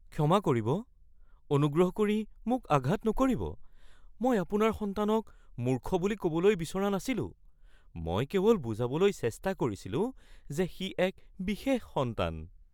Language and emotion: Assamese, fearful